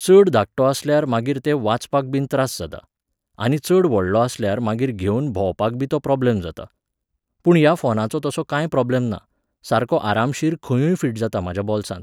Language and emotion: Goan Konkani, neutral